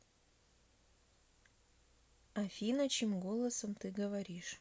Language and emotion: Russian, neutral